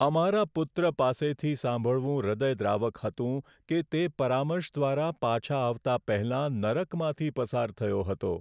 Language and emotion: Gujarati, sad